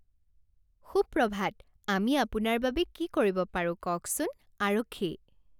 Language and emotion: Assamese, happy